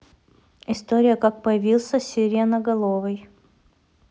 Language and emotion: Russian, neutral